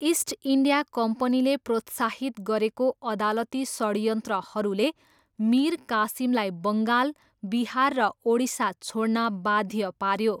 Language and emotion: Nepali, neutral